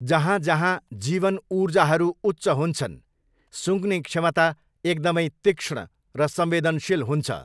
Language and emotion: Nepali, neutral